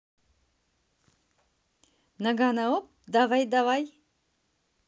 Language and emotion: Russian, positive